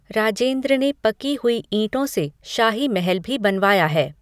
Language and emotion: Hindi, neutral